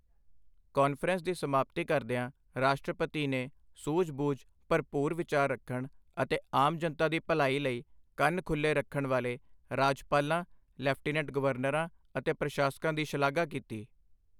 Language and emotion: Punjabi, neutral